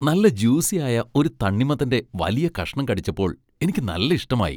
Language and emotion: Malayalam, happy